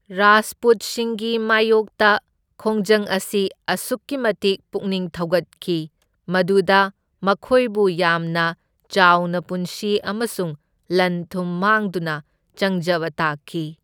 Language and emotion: Manipuri, neutral